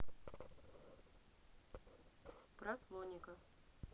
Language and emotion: Russian, neutral